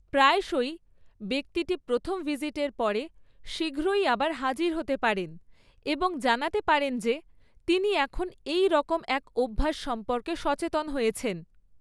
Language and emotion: Bengali, neutral